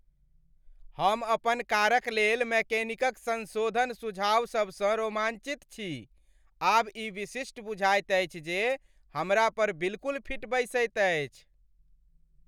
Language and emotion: Maithili, happy